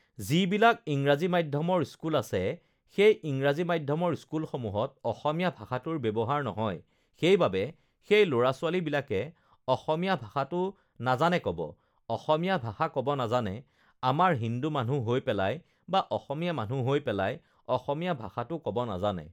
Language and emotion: Assamese, neutral